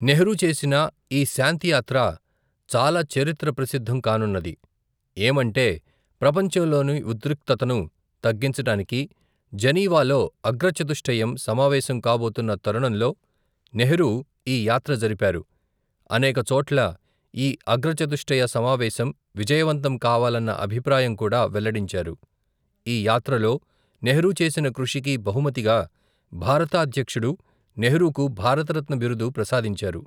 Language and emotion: Telugu, neutral